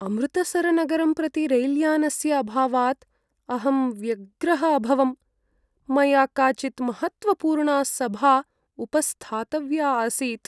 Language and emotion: Sanskrit, sad